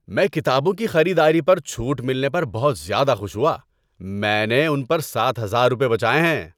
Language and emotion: Urdu, happy